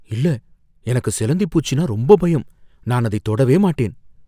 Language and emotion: Tamil, fearful